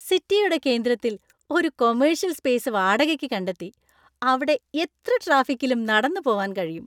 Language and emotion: Malayalam, happy